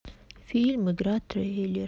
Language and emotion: Russian, sad